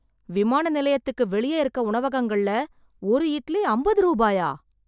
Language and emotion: Tamil, surprised